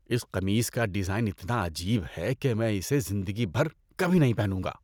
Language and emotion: Urdu, disgusted